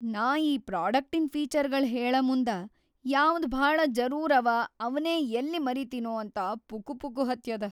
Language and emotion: Kannada, fearful